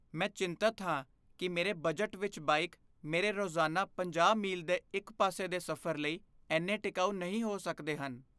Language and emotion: Punjabi, fearful